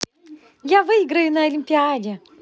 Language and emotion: Russian, positive